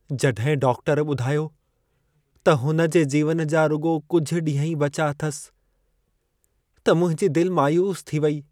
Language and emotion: Sindhi, sad